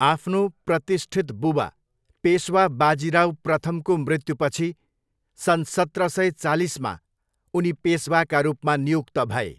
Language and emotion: Nepali, neutral